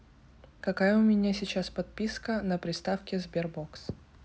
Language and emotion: Russian, neutral